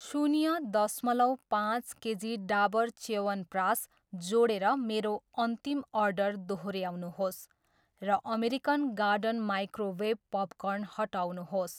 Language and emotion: Nepali, neutral